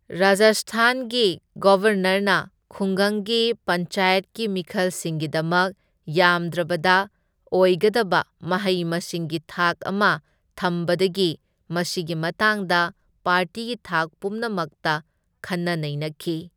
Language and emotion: Manipuri, neutral